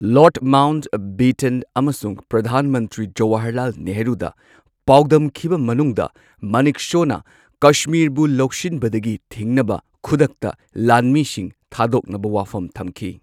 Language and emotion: Manipuri, neutral